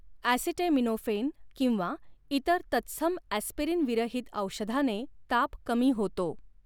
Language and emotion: Marathi, neutral